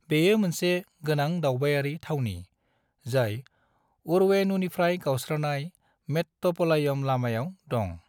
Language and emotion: Bodo, neutral